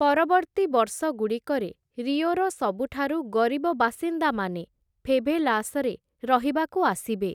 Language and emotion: Odia, neutral